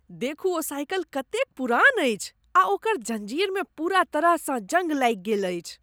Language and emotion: Maithili, disgusted